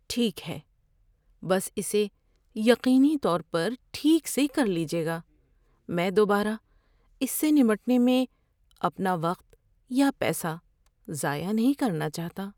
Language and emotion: Urdu, fearful